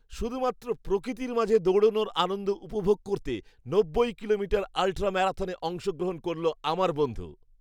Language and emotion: Bengali, happy